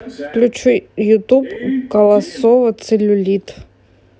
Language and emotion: Russian, neutral